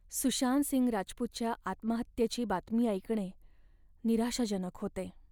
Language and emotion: Marathi, sad